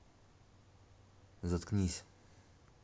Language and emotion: Russian, neutral